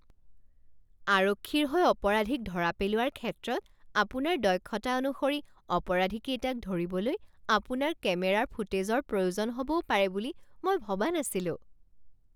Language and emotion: Assamese, surprised